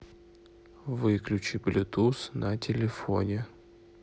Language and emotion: Russian, neutral